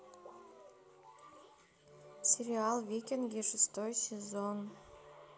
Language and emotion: Russian, neutral